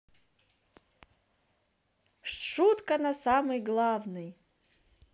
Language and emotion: Russian, positive